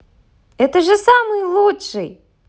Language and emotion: Russian, positive